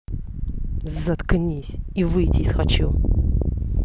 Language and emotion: Russian, angry